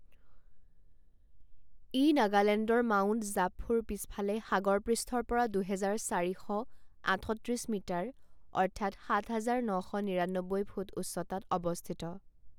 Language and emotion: Assamese, neutral